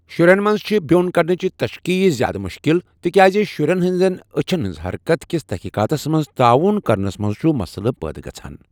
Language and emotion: Kashmiri, neutral